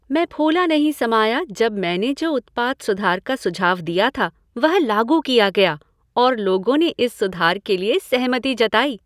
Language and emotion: Hindi, happy